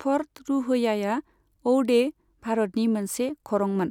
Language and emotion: Bodo, neutral